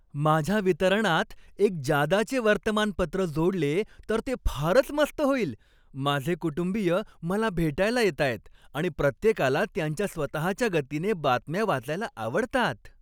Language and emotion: Marathi, happy